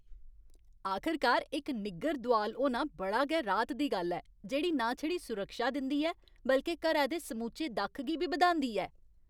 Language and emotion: Dogri, happy